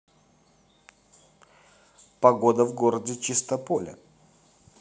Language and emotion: Russian, neutral